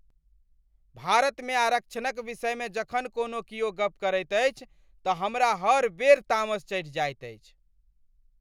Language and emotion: Maithili, angry